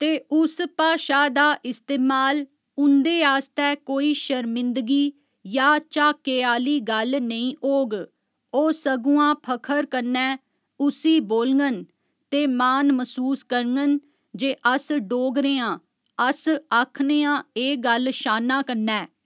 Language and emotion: Dogri, neutral